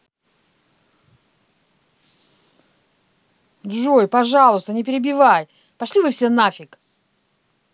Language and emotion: Russian, angry